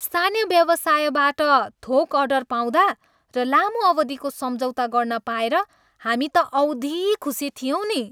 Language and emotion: Nepali, happy